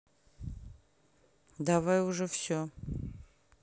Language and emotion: Russian, neutral